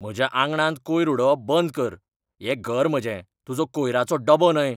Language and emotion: Goan Konkani, angry